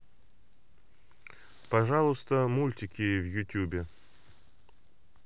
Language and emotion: Russian, neutral